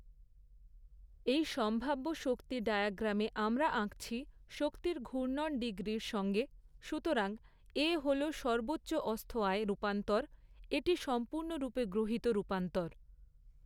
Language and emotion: Bengali, neutral